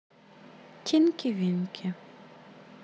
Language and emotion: Russian, neutral